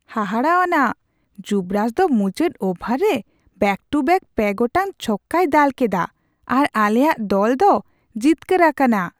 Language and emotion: Santali, surprised